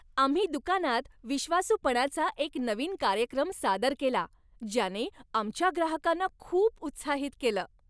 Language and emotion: Marathi, happy